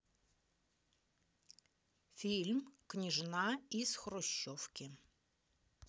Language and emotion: Russian, neutral